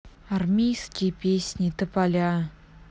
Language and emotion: Russian, neutral